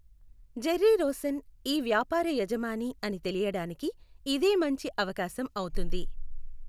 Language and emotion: Telugu, neutral